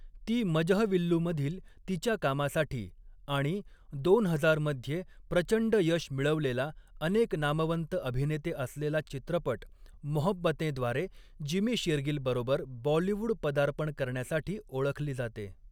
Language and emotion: Marathi, neutral